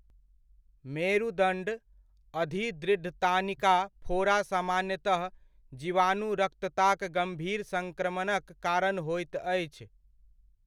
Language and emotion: Maithili, neutral